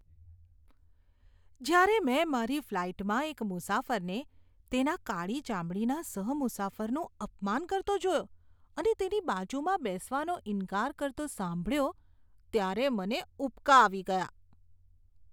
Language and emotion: Gujarati, disgusted